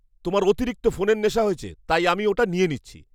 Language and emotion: Bengali, angry